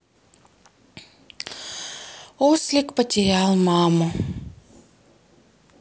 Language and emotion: Russian, sad